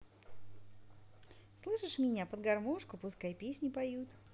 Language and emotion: Russian, positive